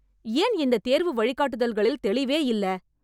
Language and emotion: Tamil, angry